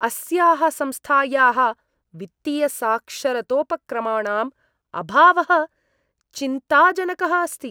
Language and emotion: Sanskrit, disgusted